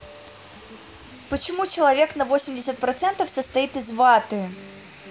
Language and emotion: Russian, neutral